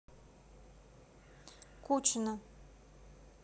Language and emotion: Russian, neutral